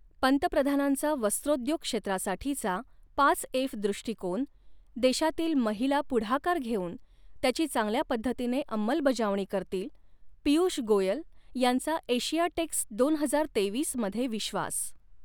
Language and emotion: Marathi, neutral